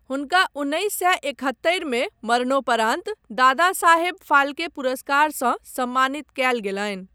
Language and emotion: Maithili, neutral